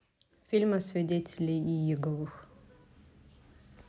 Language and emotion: Russian, neutral